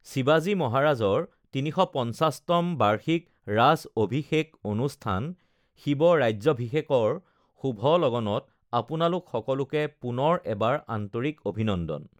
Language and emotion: Assamese, neutral